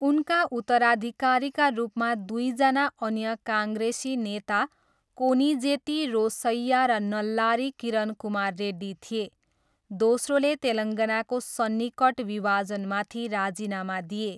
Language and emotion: Nepali, neutral